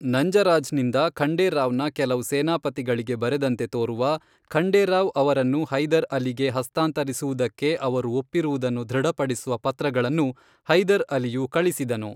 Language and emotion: Kannada, neutral